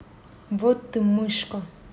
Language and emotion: Russian, angry